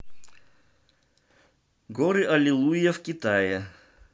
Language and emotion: Russian, neutral